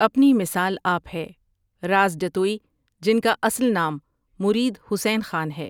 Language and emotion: Urdu, neutral